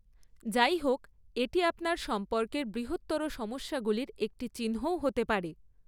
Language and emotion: Bengali, neutral